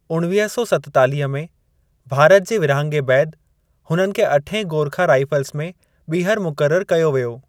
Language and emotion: Sindhi, neutral